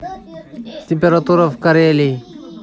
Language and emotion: Russian, neutral